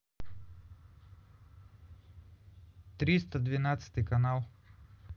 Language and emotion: Russian, neutral